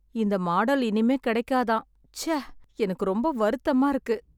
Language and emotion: Tamil, sad